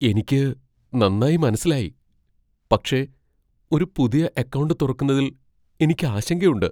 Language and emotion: Malayalam, fearful